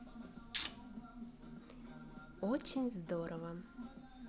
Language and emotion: Russian, positive